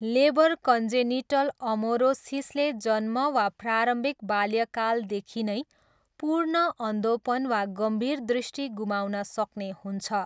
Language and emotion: Nepali, neutral